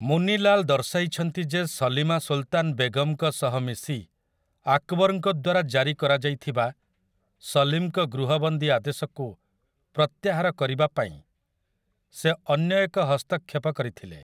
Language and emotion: Odia, neutral